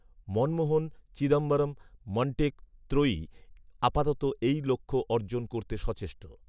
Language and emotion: Bengali, neutral